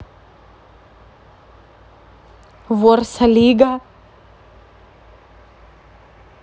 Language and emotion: Russian, positive